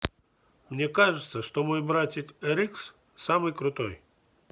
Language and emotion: Russian, neutral